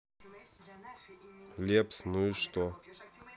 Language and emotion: Russian, neutral